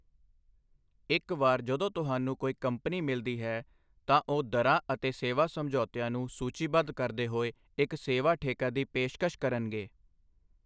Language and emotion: Punjabi, neutral